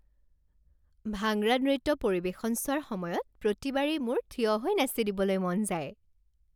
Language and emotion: Assamese, happy